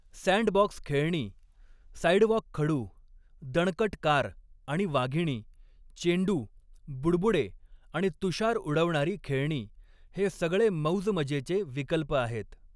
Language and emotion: Marathi, neutral